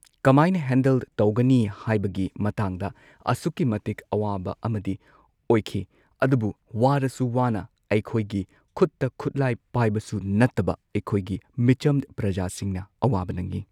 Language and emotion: Manipuri, neutral